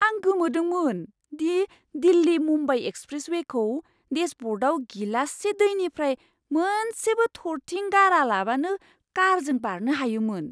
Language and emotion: Bodo, surprised